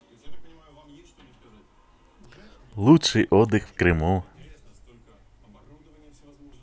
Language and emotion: Russian, positive